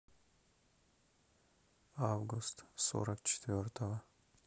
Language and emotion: Russian, neutral